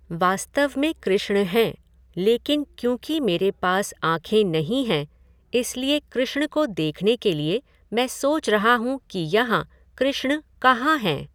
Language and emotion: Hindi, neutral